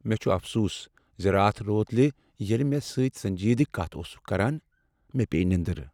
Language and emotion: Kashmiri, sad